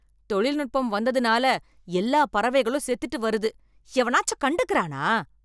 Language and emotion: Tamil, angry